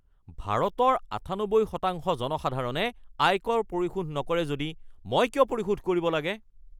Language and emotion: Assamese, angry